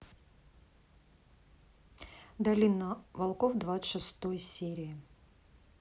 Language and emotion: Russian, neutral